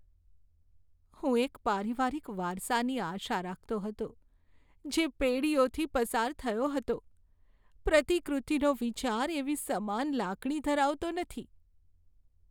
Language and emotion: Gujarati, sad